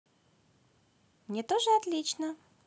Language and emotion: Russian, positive